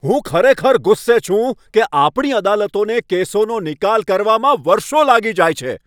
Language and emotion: Gujarati, angry